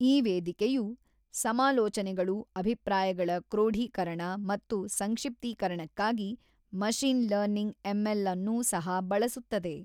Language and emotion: Kannada, neutral